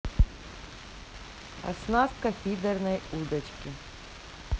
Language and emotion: Russian, neutral